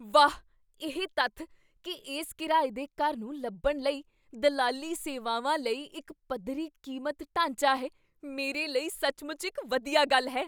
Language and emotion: Punjabi, surprised